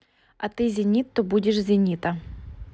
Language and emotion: Russian, neutral